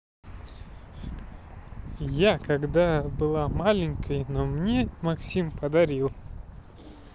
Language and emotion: Russian, neutral